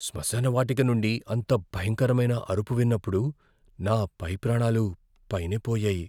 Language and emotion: Telugu, fearful